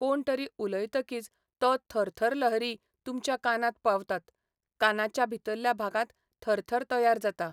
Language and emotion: Goan Konkani, neutral